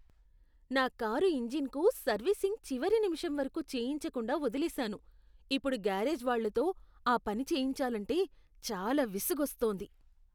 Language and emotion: Telugu, disgusted